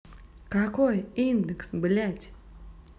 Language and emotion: Russian, angry